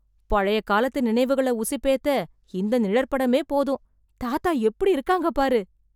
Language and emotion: Tamil, surprised